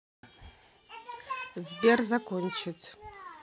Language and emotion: Russian, neutral